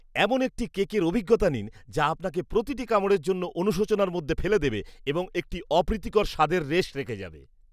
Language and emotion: Bengali, disgusted